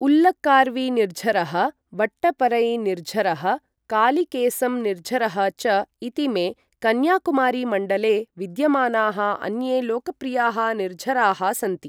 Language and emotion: Sanskrit, neutral